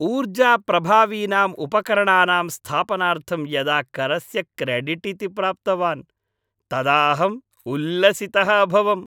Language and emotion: Sanskrit, happy